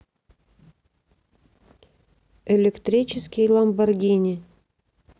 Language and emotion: Russian, neutral